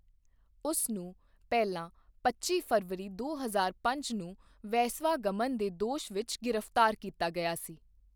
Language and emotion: Punjabi, neutral